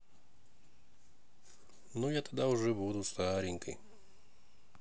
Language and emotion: Russian, sad